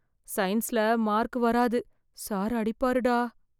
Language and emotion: Tamil, fearful